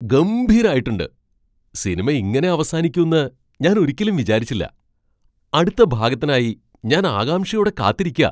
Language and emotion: Malayalam, surprised